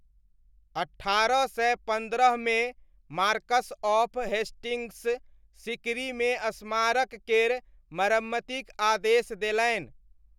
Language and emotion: Maithili, neutral